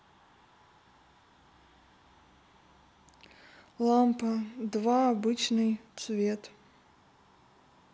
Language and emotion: Russian, neutral